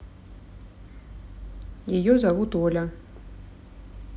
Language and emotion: Russian, neutral